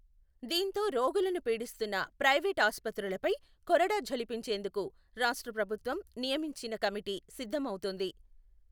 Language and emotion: Telugu, neutral